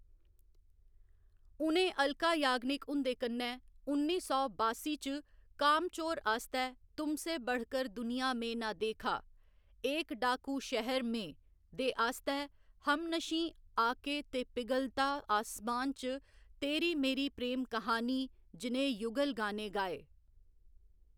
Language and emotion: Dogri, neutral